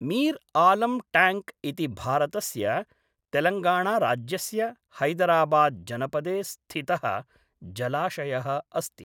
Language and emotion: Sanskrit, neutral